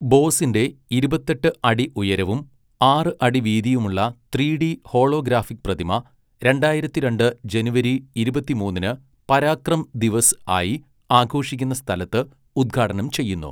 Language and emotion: Malayalam, neutral